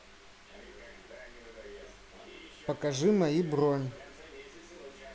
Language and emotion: Russian, neutral